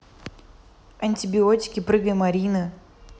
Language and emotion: Russian, neutral